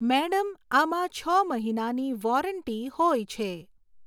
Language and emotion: Gujarati, neutral